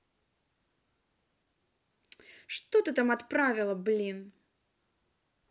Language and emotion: Russian, angry